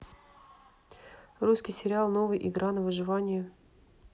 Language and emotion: Russian, neutral